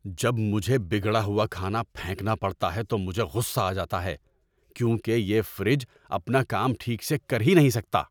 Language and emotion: Urdu, angry